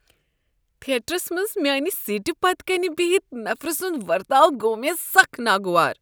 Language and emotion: Kashmiri, disgusted